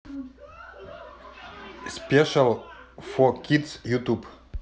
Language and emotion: Russian, neutral